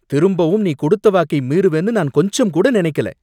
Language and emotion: Tamil, angry